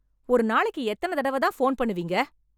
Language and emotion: Tamil, angry